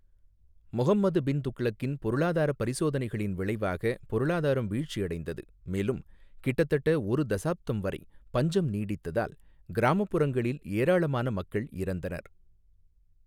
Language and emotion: Tamil, neutral